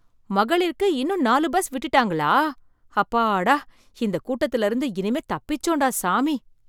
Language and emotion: Tamil, surprised